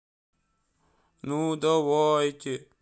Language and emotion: Russian, sad